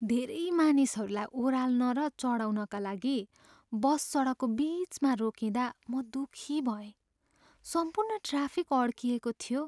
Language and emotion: Nepali, sad